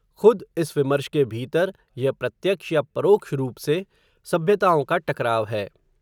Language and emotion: Hindi, neutral